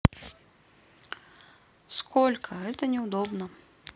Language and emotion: Russian, neutral